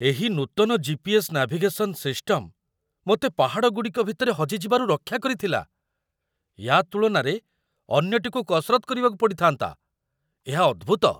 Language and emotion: Odia, surprised